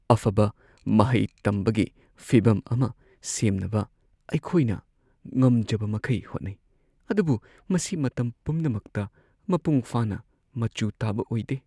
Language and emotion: Manipuri, sad